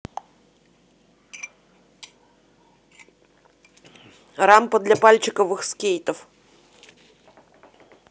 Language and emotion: Russian, neutral